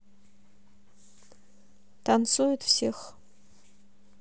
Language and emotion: Russian, neutral